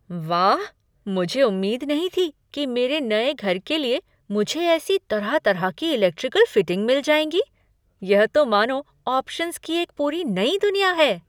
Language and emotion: Hindi, surprised